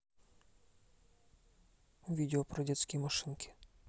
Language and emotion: Russian, neutral